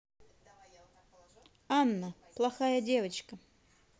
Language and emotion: Russian, neutral